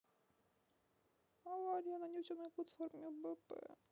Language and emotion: Russian, sad